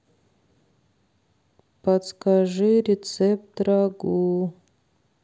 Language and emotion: Russian, sad